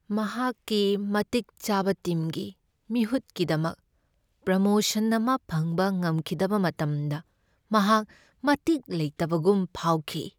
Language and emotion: Manipuri, sad